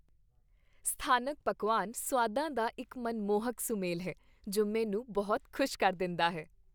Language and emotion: Punjabi, happy